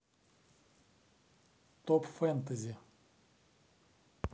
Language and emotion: Russian, neutral